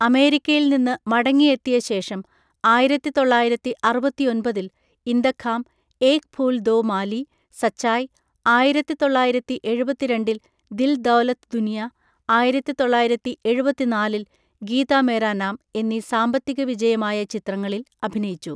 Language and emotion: Malayalam, neutral